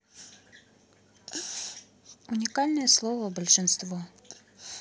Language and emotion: Russian, neutral